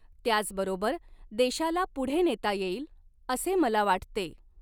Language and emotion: Marathi, neutral